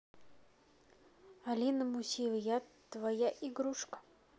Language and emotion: Russian, neutral